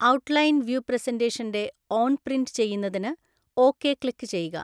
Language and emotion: Malayalam, neutral